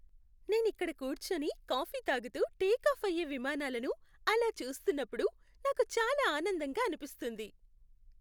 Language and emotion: Telugu, happy